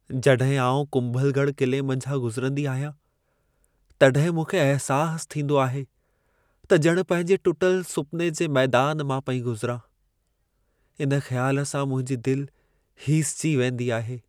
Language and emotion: Sindhi, sad